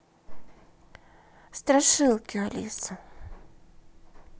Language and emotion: Russian, neutral